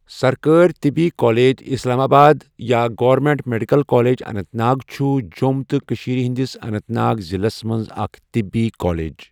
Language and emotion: Kashmiri, neutral